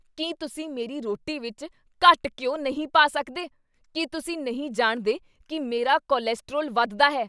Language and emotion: Punjabi, angry